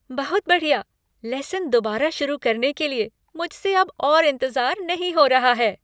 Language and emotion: Hindi, happy